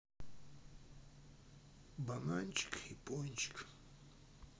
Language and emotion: Russian, sad